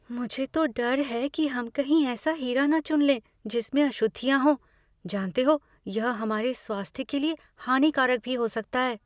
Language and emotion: Hindi, fearful